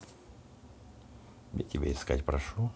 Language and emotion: Russian, neutral